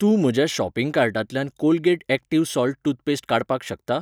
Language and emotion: Goan Konkani, neutral